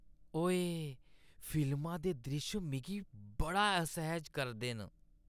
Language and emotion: Dogri, disgusted